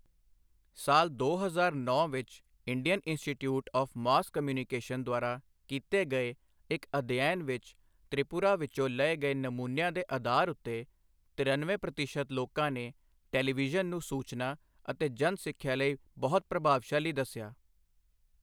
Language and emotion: Punjabi, neutral